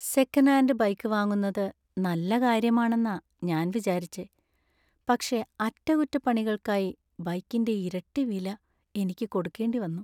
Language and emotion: Malayalam, sad